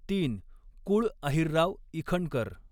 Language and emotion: Marathi, neutral